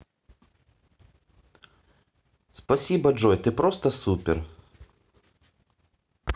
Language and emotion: Russian, positive